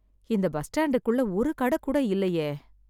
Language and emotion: Tamil, sad